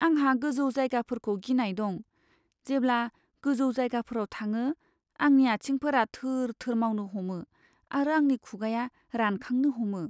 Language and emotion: Bodo, fearful